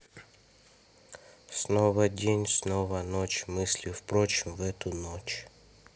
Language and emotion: Russian, neutral